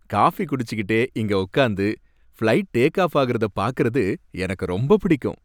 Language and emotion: Tamil, happy